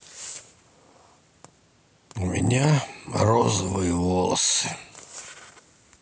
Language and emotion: Russian, sad